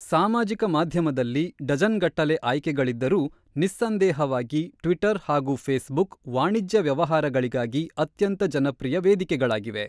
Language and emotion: Kannada, neutral